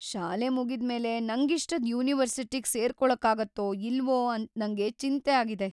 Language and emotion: Kannada, fearful